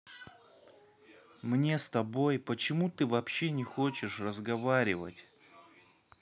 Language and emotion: Russian, neutral